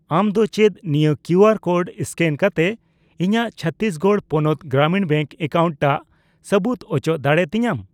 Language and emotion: Santali, neutral